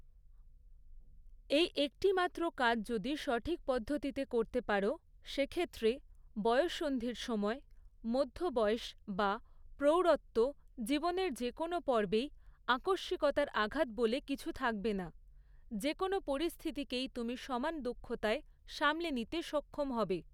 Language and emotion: Bengali, neutral